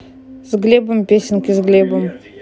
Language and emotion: Russian, neutral